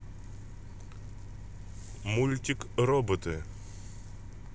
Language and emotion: Russian, neutral